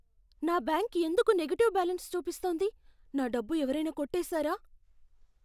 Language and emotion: Telugu, fearful